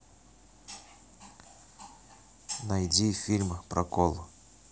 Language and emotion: Russian, neutral